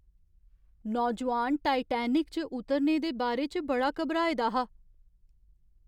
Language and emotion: Dogri, fearful